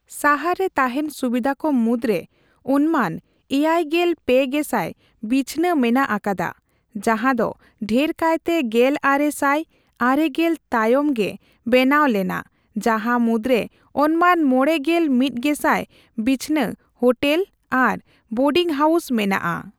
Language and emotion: Santali, neutral